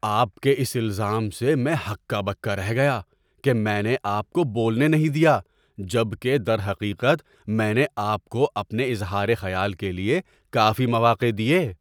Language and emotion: Urdu, surprised